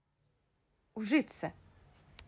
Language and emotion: Russian, neutral